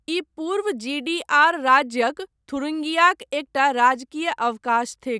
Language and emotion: Maithili, neutral